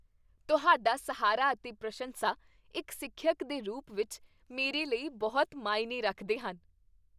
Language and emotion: Punjabi, happy